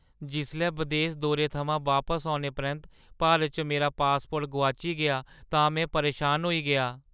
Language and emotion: Dogri, sad